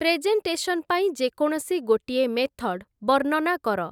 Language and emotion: Odia, neutral